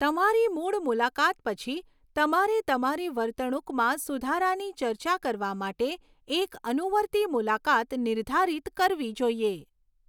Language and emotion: Gujarati, neutral